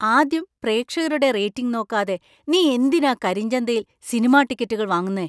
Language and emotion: Malayalam, surprised